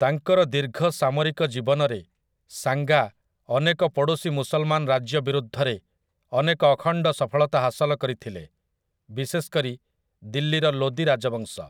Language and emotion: Odia, neutral